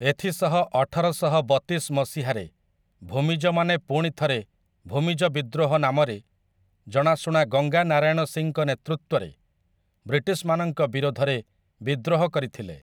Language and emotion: Odia, neutral